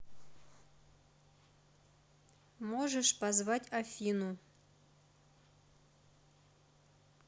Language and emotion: Russian, neutral